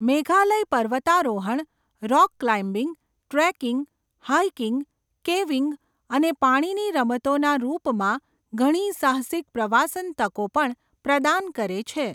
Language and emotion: Gujarati, neutral